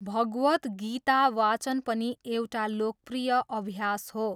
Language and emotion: Nepali, neutral